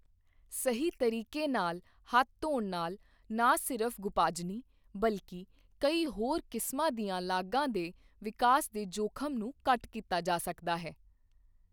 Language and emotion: Punjabi, neutral